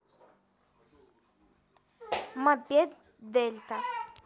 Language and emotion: Russian, neutral